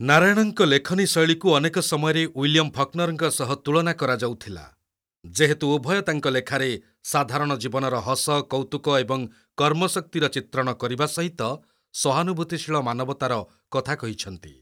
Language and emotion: Odia, neutral